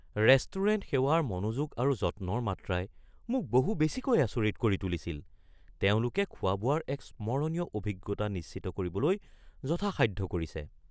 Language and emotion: Assamese, surprised